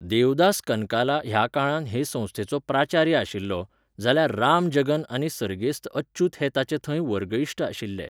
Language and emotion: Goan Konkani, neutral